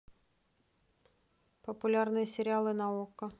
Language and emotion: Russian, neutral